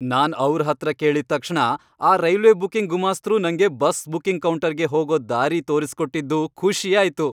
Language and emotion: Kannada, happy